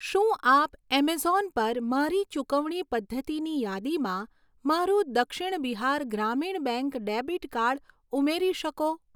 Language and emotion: Gujarati, neutral